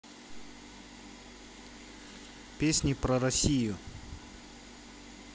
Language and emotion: Russian, neutral